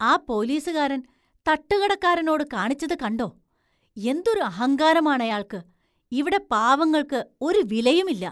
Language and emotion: Malayalam, disgusted